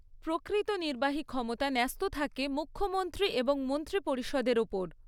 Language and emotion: Bengali, neutral